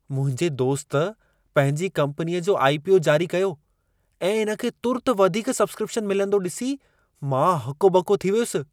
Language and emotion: Sindhi, surprised